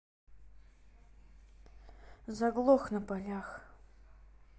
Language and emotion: Russian, sad